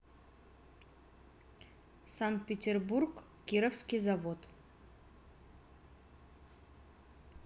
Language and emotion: Russian, neutral